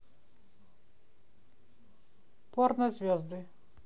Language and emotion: Russian, neutral